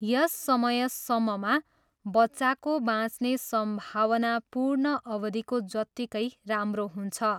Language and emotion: Nepali, neutral